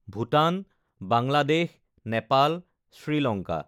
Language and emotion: Assamese, neutral